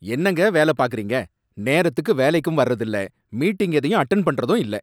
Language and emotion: Tamil, angry